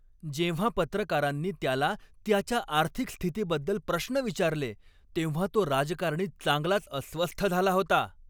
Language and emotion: Marathi, angry